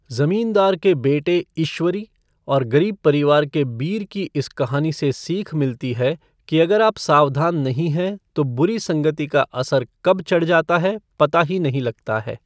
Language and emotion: Hindi, neutral